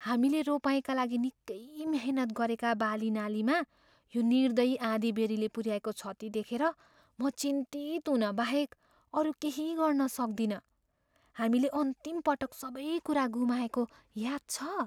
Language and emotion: Nepali, fearful